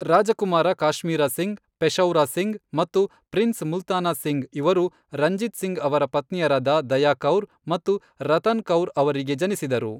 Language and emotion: Kannada, neutral